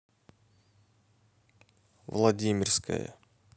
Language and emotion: Russian, neutral